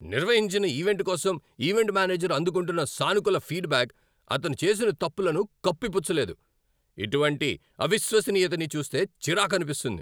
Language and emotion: Telugu, angry